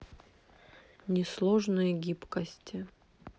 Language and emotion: Russian, neutral